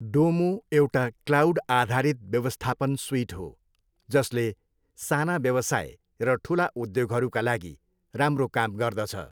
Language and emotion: Nepali, neutral